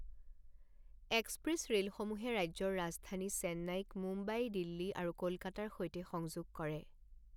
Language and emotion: Assamese, neutral